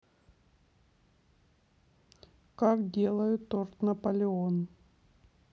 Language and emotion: Russian, neutral